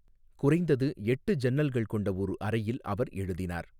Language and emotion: Tamil, neutral